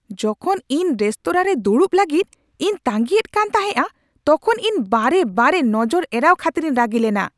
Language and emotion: Santali, angry